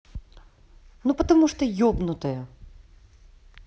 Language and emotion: Russian, angry